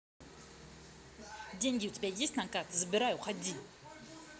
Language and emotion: Russian, angry